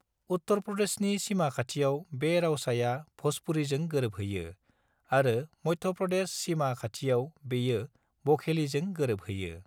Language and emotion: Bodo, neutral